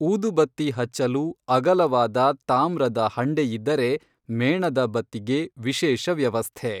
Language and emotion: Kannada, neutral